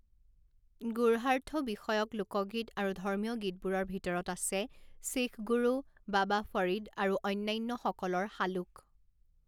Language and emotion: Assamese, neutral